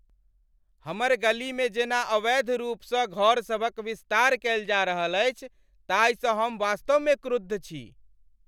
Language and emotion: Maithili, angry